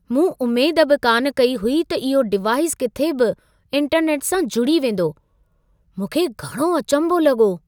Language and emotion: Sindhi, surprised